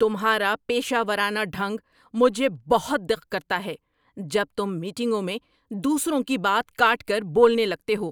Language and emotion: Urdu, angry